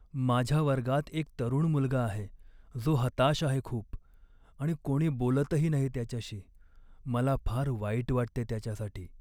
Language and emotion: Marathi, sad